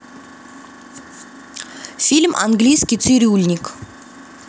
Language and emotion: Russian, neutral